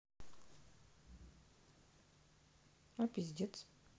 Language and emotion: Russian, neutral